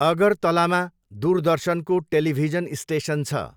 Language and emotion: Nepali, neutral